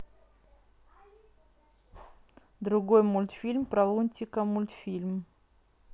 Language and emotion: Russian, neutral